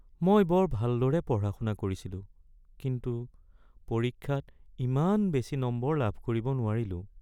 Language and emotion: Assamese, sad